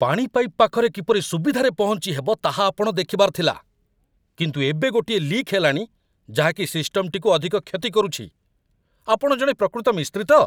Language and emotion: Odia, angry